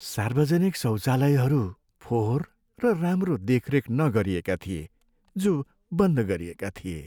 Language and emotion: Nepali, sad